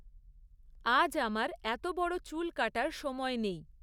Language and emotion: Bengali, neutral